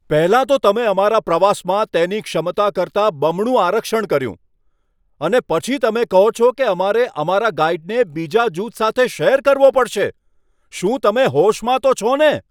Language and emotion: Gujarati, angry